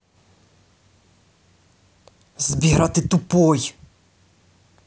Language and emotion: Russian, angry